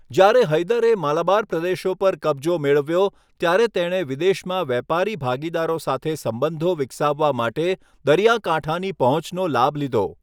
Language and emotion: Gujarati, neutral